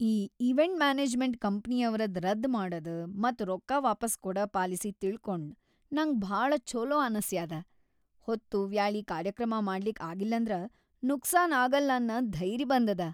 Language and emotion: Kannada, happy